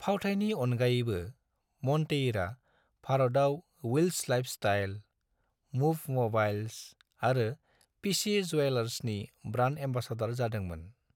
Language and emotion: Bodo, neutral